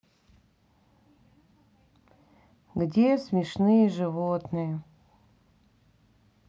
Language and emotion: Russian, sad